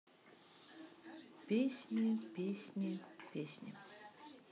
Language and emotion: Russian, sad